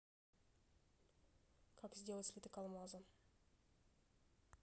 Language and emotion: Russian, neutral